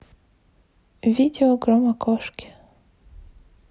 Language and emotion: Russian, neutral